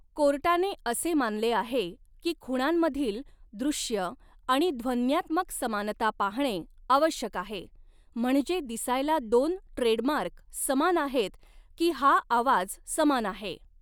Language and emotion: Marathi, neutral